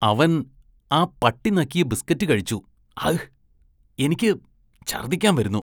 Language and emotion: Malayalam, disgusted